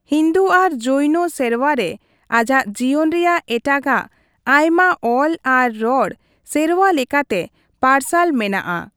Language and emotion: Santali, neutral